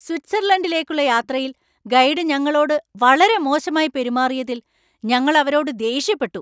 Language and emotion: Malayalam, angry